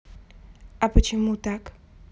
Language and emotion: Russian, neutral